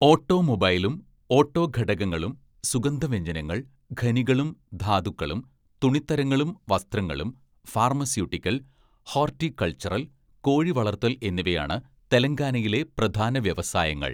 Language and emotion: Malayalam, neutral